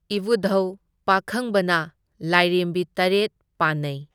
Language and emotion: Manipuri, neutral